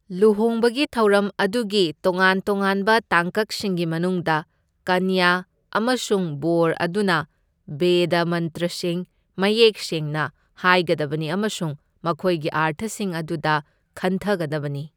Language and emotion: Manipuri, neutral